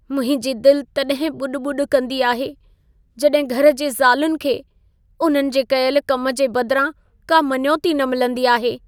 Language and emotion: Sindhi, sad